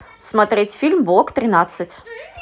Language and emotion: Russian, neutral